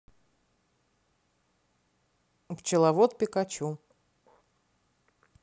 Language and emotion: Russian, neutral